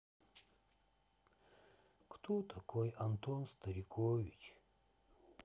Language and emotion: Russian, sad